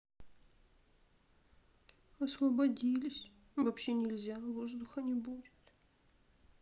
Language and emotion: Russian, sad